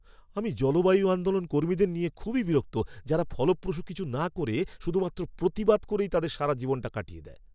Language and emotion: Bengali, angry